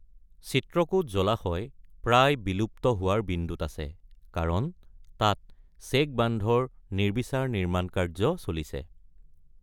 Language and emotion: Assamese, neutral